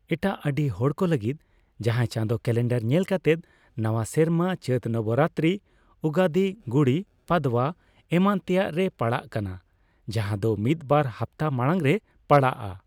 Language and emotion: Santali, neutral